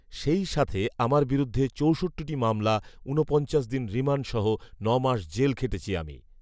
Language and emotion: Bengali, neutral